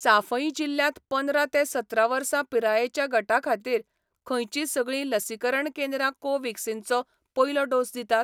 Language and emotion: Goan Konkani, neutral